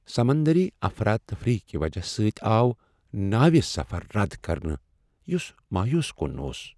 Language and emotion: Kashmiri, sad